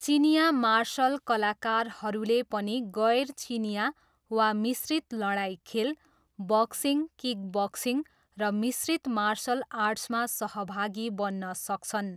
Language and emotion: Nepali, neutral